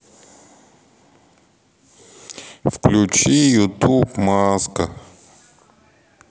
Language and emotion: Russian, sad